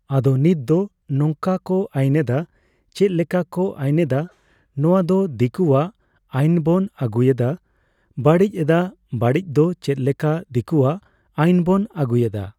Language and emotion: Santali, neutral